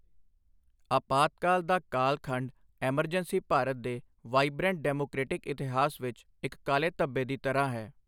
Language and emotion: Punjabi, neutral